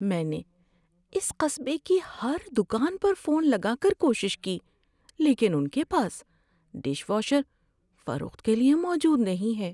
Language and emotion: Urdu, sad